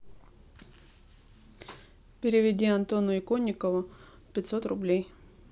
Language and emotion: Russian, neutral